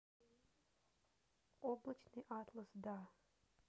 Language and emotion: Russian, neutral